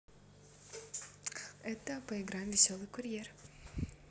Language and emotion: Russian, neutral